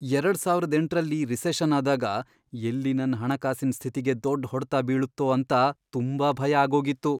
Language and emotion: Kannada, fearful